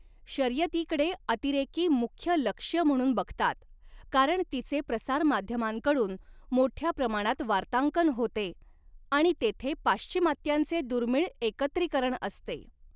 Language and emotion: Marathi, neutral